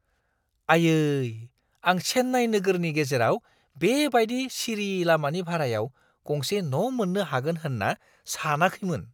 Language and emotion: Bodo, surprised